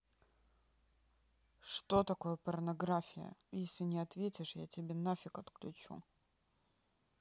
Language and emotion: Russian, angry